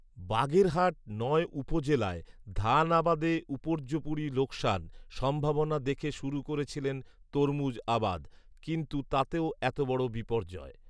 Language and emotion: Bengali, neutral